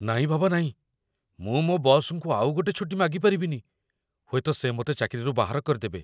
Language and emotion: Odia, fearful